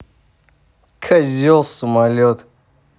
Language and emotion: Russian, angry